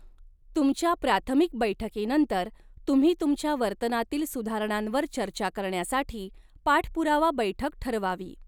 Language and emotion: Marathi, neutral